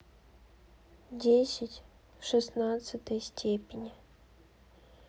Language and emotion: Russian, neutral